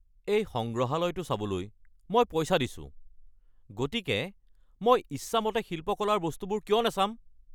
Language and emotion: Assamese, angry